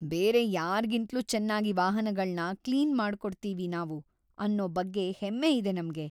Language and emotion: Kannada, happy